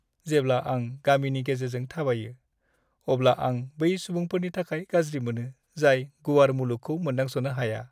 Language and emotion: Bodo, sad